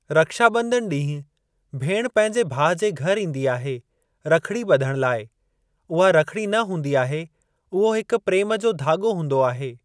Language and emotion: Sindhi, neutral